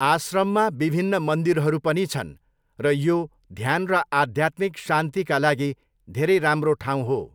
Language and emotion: Nepali, neutral